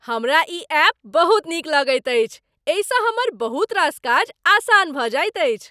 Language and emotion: Maithili, happy